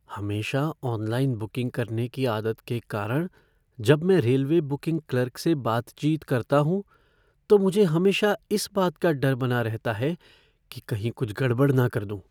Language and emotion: Hindi, fearful